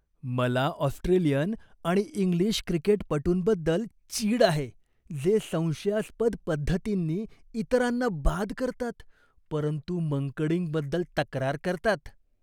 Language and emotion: Marathi, disgusted